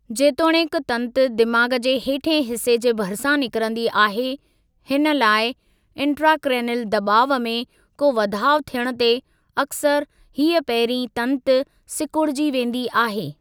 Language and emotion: Sindhi, neutral